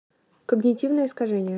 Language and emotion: Russian, neutral